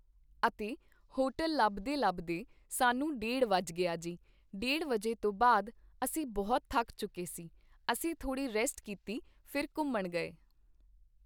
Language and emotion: Punjabi, neutral